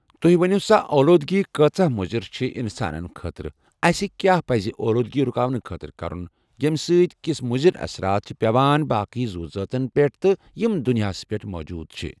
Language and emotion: Kashmiri, neutral